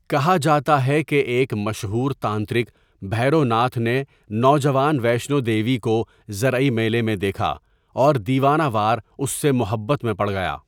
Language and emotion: Urdu, neutral